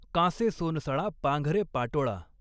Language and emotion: Marathi, neutral